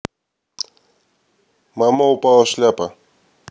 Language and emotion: Russian, neutral